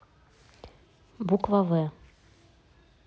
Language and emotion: Russian, neutral